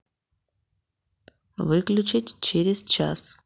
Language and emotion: Russian, neutral